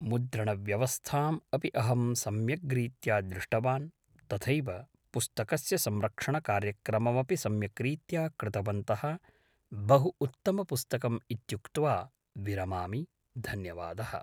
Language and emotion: Sanskrit, neutral